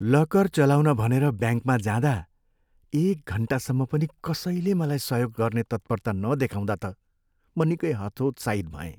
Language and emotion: Nepali, sad